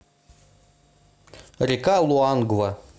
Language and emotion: Russian, neutral